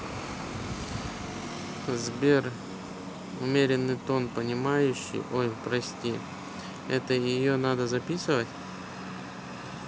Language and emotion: Russian, neutral